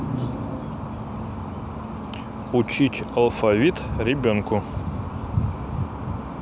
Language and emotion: Russian, neutral